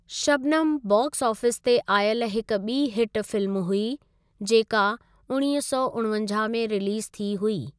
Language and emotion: Sindhi, neutral